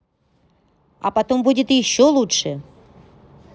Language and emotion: Russian, angry